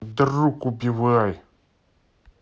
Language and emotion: Russian, angry